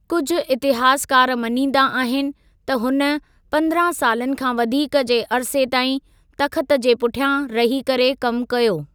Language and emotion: Sindhi, neutral